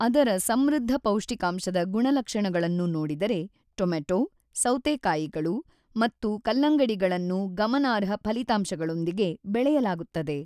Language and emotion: Kannada, neutral